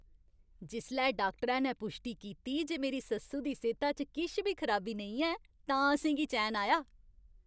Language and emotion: Dogri, happy